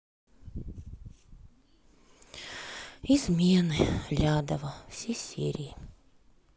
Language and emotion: Russian, sad